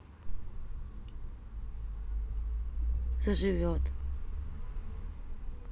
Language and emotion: Russian, neutral